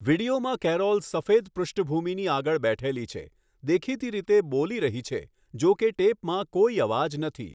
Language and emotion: Gujarati, neutral